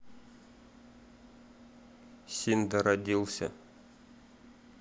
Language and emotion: Russian, neutral